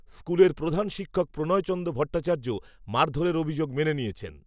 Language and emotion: Bengali, neutral